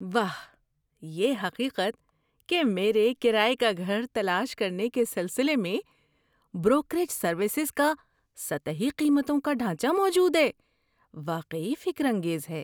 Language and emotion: Urdu, surprised